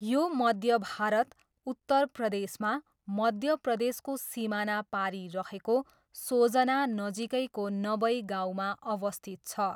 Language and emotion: Nepali, neutral